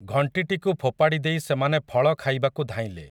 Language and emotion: Odia, neutral